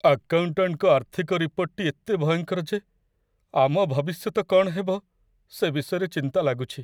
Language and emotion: Odia, sad